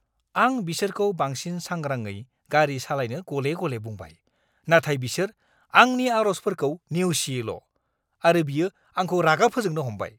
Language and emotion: Bodo, angry